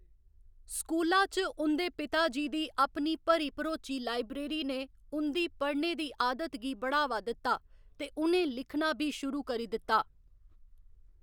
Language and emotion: Dogri, neutral